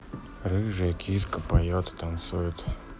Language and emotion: Russian, neutral